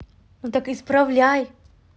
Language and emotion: Russian, angry